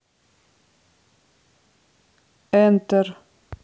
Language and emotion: Russian, neutral